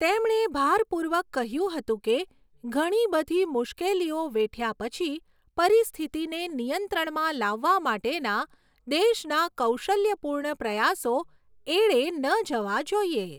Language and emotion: Gujarati, neutral